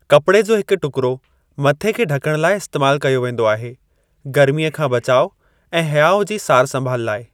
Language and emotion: Sindhi, neutral